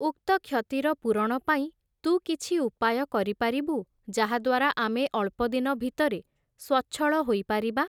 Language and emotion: Odia, neutral